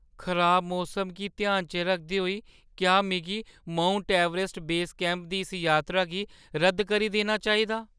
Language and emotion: Dogri, fearful